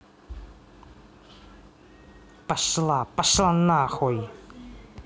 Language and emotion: Russian, angry